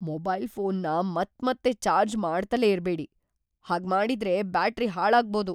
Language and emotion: Kannada, fearful